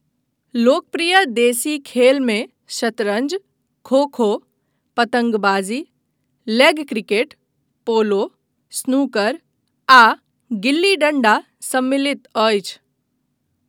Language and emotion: Maithili, neutral